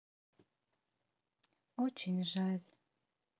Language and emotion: Russian, sad